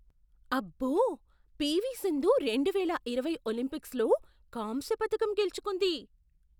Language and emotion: Telugu, surprised